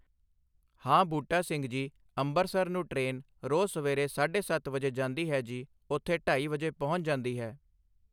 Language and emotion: Punjabi, neutral